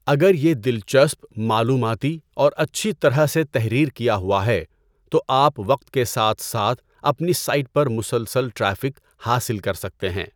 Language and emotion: Urdu, neutral